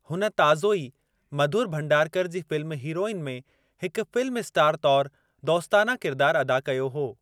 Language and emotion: Sindhi, neutral